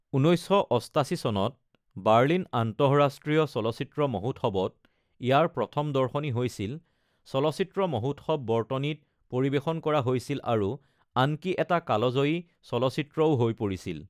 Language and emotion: Assamese, neutral